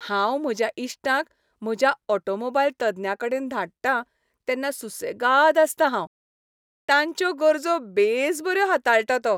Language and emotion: Goan Konkani, happy